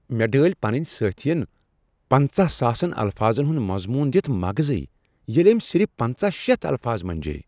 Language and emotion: Kashmiri, surprised